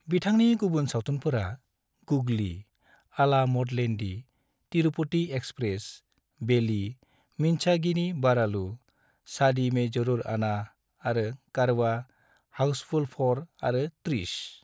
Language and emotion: Bodo, neutral